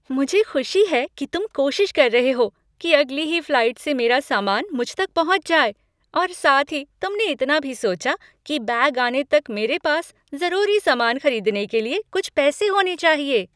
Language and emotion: Hindi, happy